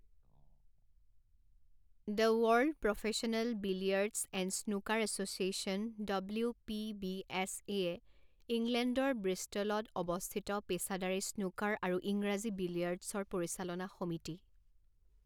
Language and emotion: Assamese, neutral